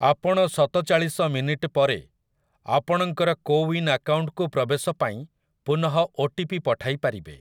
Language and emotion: Odia, neutral